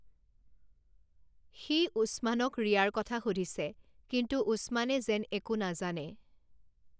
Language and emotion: Assamese, neutral